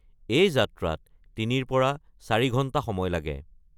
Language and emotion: Assamese, neutral